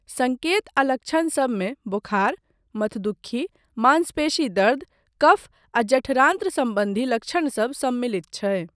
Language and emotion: Maithili, neutral